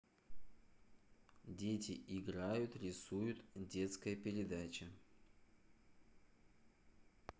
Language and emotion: Russian, neutral